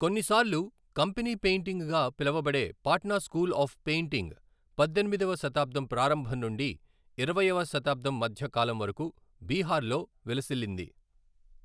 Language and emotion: Telugu, neutral